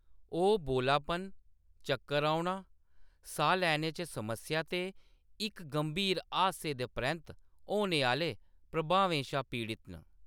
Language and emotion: Dogri, neutral